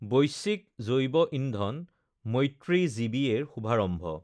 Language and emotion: Assamese, neutral